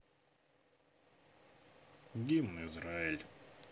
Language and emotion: Russian, sad